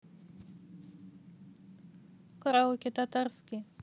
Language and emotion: Russian, neutral